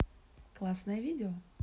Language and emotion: Russian, neutral